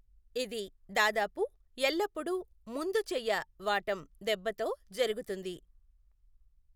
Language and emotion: Telugu, neutral